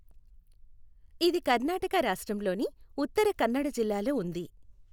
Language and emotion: Telugu, neutral